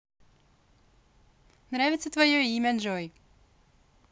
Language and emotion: Russian, positive